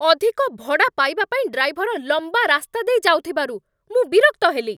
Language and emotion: Odia, angry